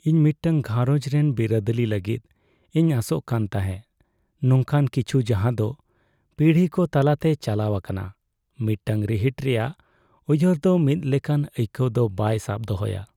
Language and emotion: Santali, sad